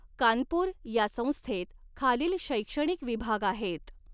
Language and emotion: Marathi, neutral